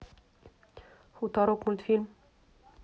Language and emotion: Russian, neutral